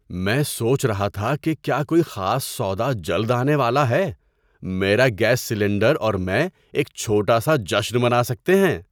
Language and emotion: Urdu, surprised